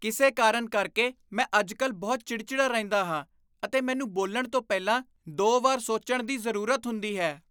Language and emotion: Punjabi, disgusted